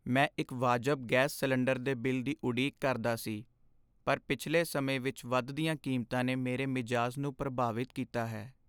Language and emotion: Punjabi, sad